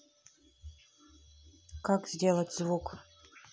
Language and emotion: Russian, neutral